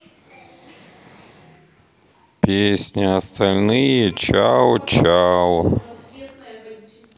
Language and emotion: Russian, sad